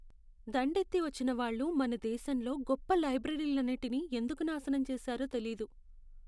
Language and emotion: Telugu, sad